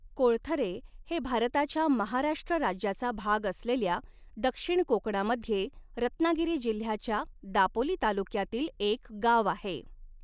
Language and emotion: Marathi, neutral